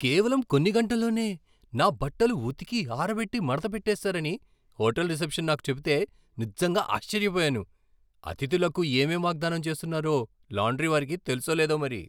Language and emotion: Telugu, surprised